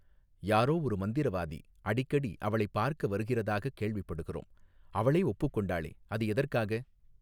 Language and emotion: Tamil, neutral